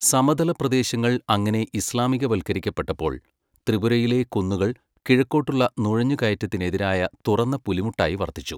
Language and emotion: Malayalam, neutral